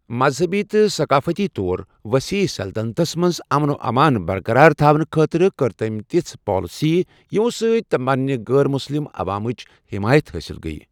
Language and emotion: Kashmiri, neutral